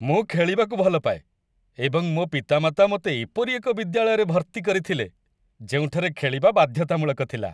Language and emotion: Odia, happy